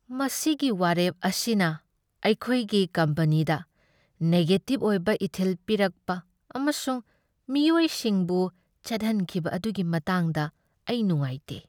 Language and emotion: Manipuri, sad